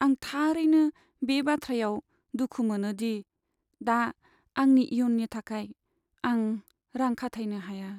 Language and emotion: Bodo, sad